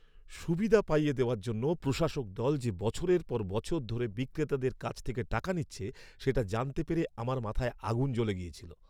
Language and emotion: Bengali, angry